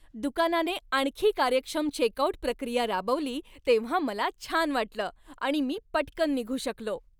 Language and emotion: Marathi, happy